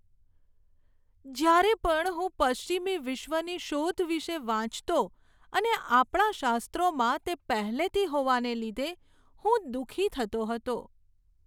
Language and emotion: Gujarati, sad